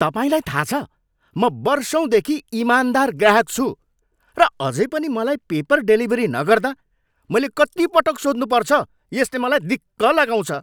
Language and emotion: Nepali, angry